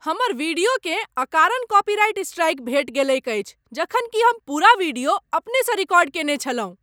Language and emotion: Maithili, angry